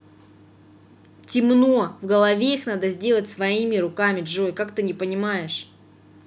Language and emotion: Russian, angry